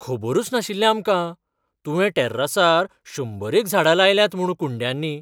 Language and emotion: Goan Konkani, surprised